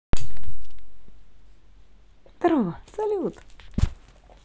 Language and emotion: Russian, positive